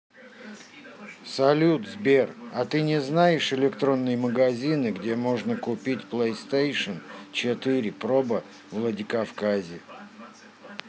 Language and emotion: Russian, neutral